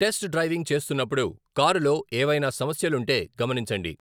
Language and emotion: Telugu, neutral